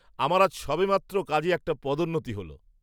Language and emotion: Bengali, happy